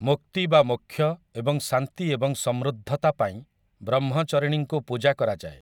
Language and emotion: Odia, neutral